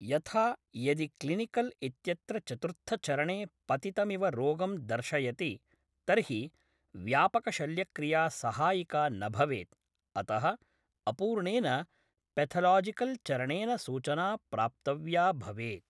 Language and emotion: Sanskrit, neutral